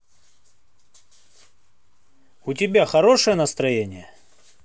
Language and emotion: Russian, neutral